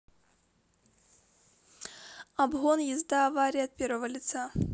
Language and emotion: Russian, neutral